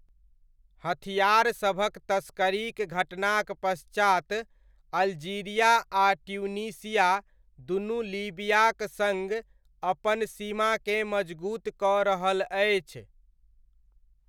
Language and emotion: Maithili, neutral